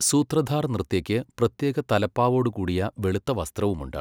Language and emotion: Malayalam, neutral